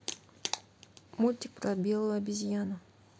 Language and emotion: Russian, neutral